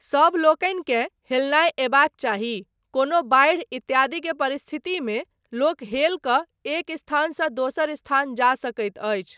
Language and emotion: Maithili, neutral